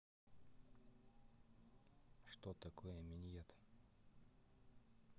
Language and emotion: Russian, neutral